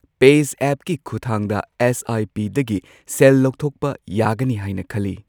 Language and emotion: Manipuri, neutral